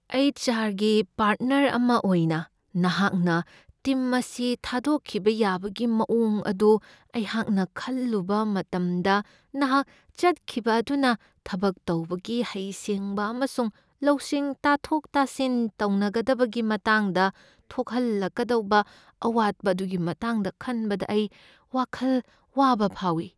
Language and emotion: Manipuri, fearful